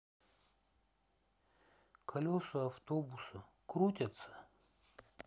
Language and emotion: Russian, sad